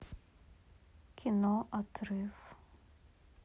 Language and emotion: Russian, sad